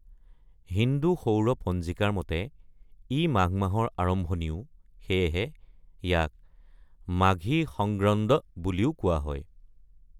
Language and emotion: Assamese, neutral